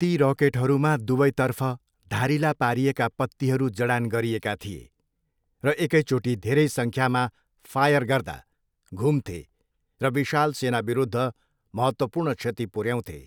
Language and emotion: Nepali, neutral